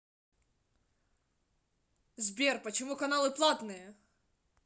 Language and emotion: Russian, angry